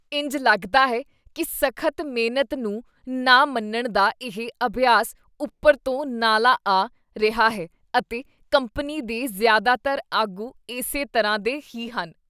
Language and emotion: Punjabi, disgusted